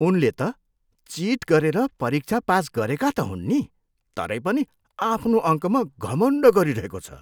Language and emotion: Nepali, disgusted